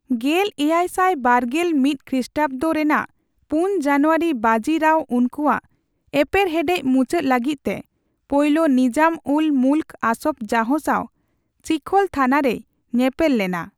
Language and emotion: Santali, neutral